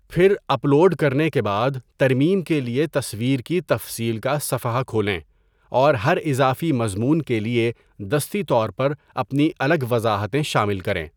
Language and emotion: Urdu, neutral